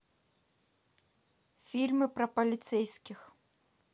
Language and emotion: Russian, neutral